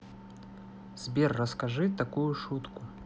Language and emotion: Russian, neutral